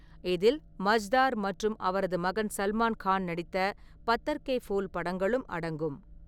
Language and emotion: Tamil, neutral